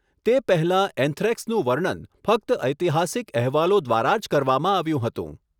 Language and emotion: Gujarati, neutral